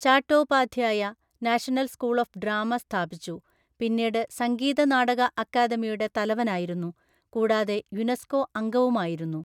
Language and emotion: Malayalam, neutral